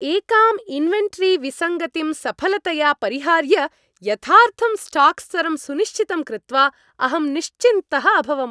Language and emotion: Sanskrit, happy